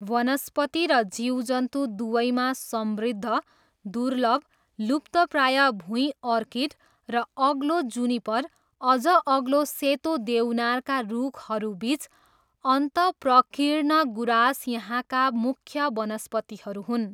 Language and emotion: Nepali, neutral